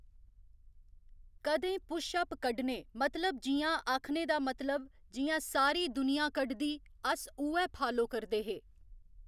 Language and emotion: Dogri, neutral